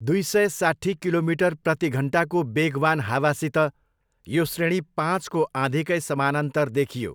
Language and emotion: Nepali, neutral